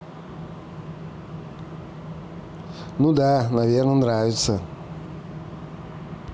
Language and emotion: Russian, neutral